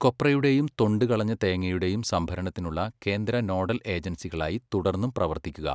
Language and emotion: Malayalam, neutral